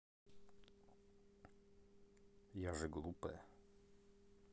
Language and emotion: Russian, neutral